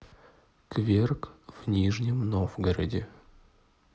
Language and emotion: Russian, neutral